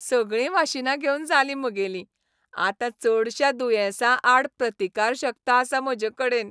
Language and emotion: Goan Konkani, happy